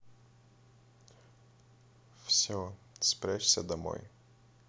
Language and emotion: Russian, neutral